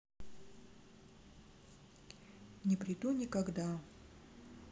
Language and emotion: Russian, sad